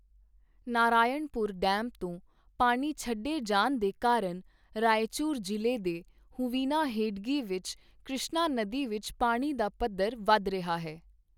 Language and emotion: Punjabi, neutral